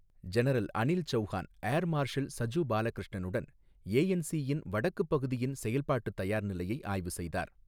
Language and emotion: Tamil, neutral